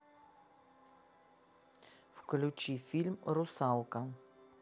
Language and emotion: Russian, neutral